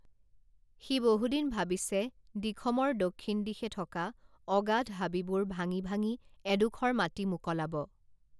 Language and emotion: Assamese, neutral